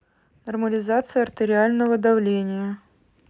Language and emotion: Russian, neutral